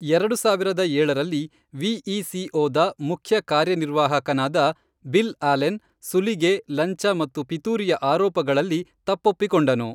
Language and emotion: Kannada, neutral